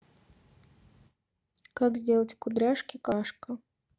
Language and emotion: Russian, neutral